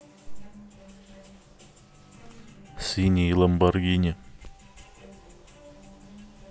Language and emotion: Russian, neutral